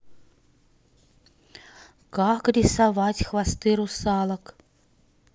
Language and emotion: Russian, neutral